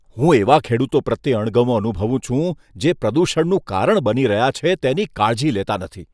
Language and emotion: Gujarati, disgusted